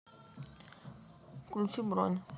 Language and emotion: Russian, neutral